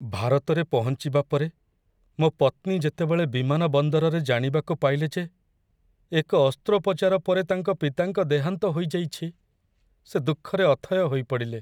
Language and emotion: Odia, sad